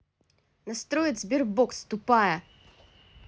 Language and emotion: Russian, angry